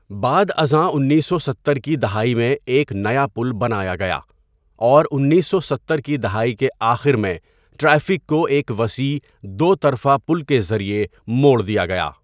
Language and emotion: Urdu, neutral